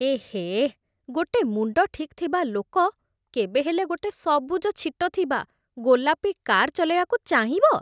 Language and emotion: Odia, disgusted